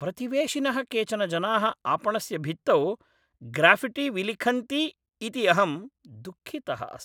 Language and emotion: Sanskrit, angry